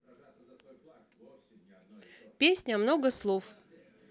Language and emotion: Russian, neutral